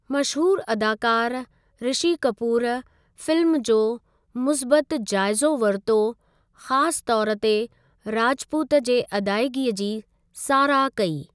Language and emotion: Sindhi, neutral